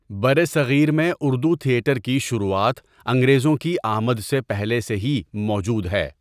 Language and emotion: Urdu, neutral